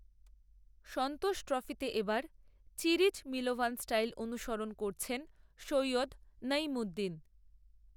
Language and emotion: Bengali, neutral